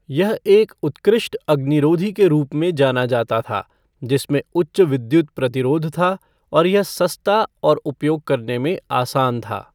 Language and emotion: Hindi, neutral